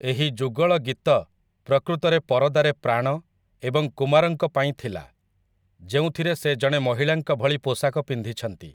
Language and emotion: Odia, neutral